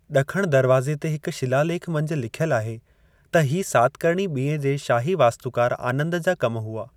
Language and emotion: Sindhi, neutral